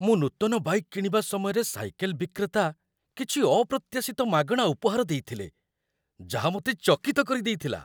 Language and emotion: Odia, surprised